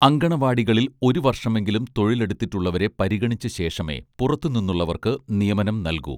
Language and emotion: Malayalam, neutral